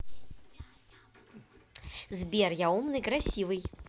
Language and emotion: Russian, positive